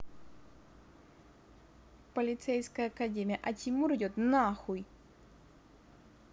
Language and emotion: Russian, angry